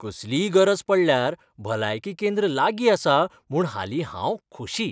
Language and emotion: Goan Konkani, happy